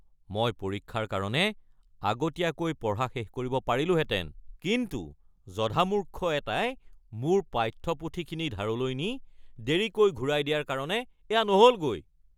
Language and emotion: Assamese, angry